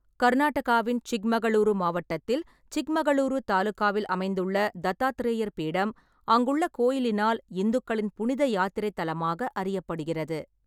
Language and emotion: Tamil, neutral